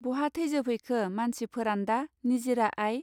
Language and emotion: Bodo, neutral